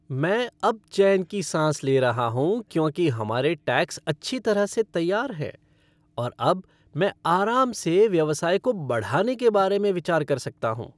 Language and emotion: Hindi, happy